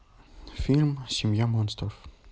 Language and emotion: Russian, neutral